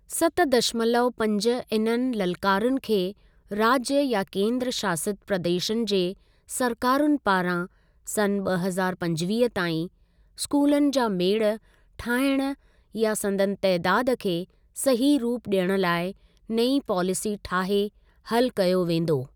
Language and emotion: Sindhi, neutral